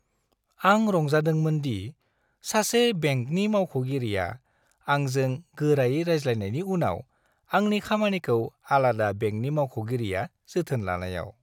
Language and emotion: Bodo, happy